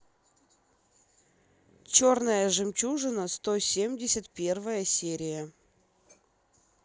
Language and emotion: Russian, neutral